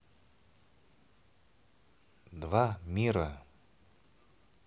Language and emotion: Russian, neutral